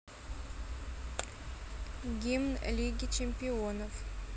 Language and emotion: Russian, neutral